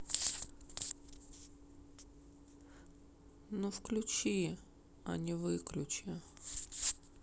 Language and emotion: Russian, sad